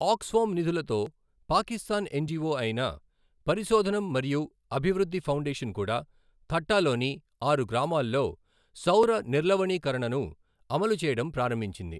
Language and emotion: Telugu, neutral